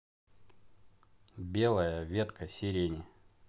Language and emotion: Russian, neutral